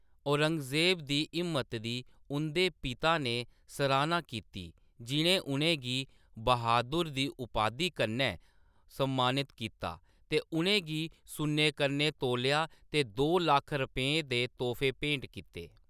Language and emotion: Dogri, neutral